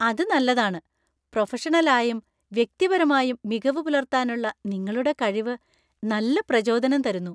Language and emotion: Malayalam, happy